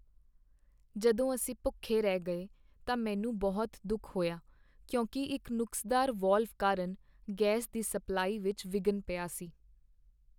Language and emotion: Punjabi, sad